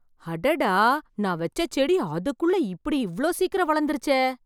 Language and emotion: Tamil, surprised